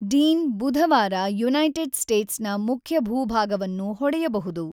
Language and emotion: Kannada, neutral